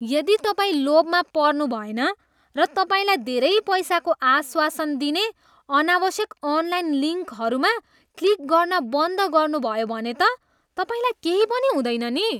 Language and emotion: Nepali, disgusted